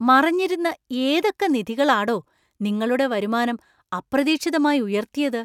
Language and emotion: Malayalam, surprised